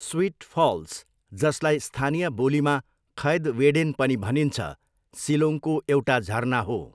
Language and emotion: Nepali, neutral